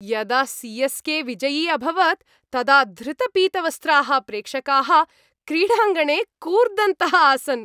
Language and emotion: Sanskrit, happy